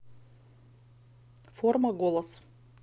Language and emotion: Russian, neutral